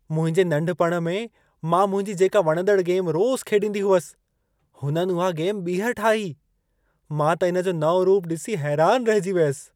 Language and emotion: Sindhi, surprised